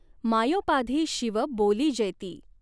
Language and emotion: Marathi, neutral